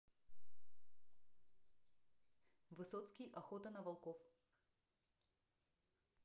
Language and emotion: Russian, neutral